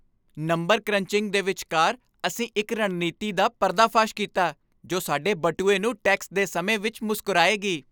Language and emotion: Punjabi, happy